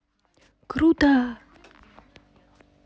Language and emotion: Russian, positive